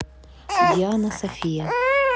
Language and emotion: Russian, neutral